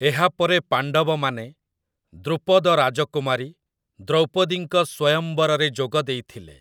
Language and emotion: Odia, neutral